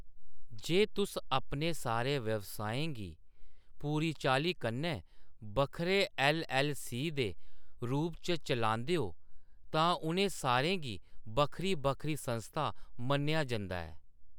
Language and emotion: Dogri, neutral